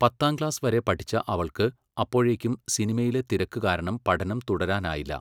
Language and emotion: Malayalam, neutral